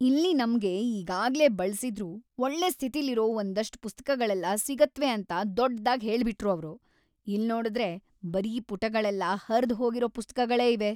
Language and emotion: Kannada, angry